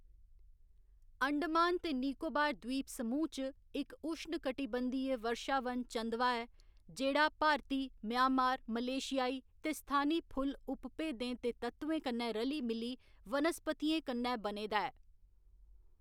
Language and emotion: Dogri, neutral